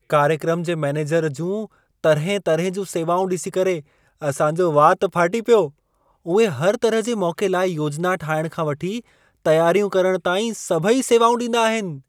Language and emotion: Sindhi, surprised